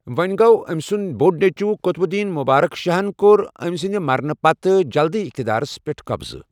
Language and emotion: Kashmiri, neutral